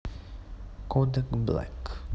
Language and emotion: Russian, neutral